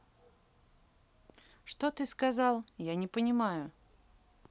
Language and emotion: Russian, neutral